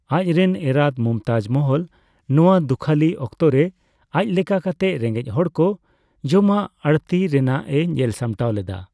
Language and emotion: Santali, neutral